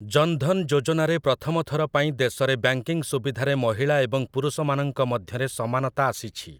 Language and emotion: Odia, neutral